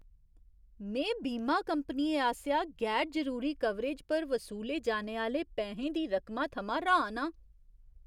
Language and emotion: Dogri, surprised